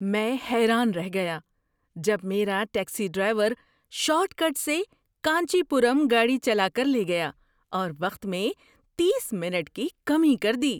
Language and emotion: Urdu, surprised